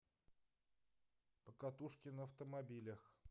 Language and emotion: Russian, neutral